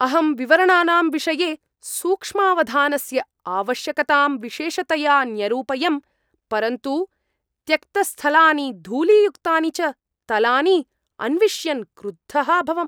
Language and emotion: Sanskrit, angry